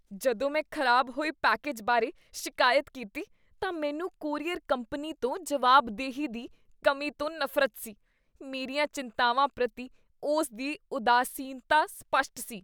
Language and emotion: Punjabi, disgusted